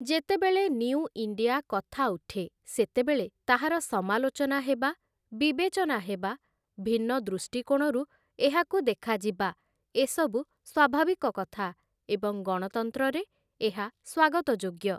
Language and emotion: Odia, neutral